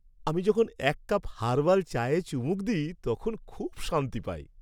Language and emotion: Bengali, happy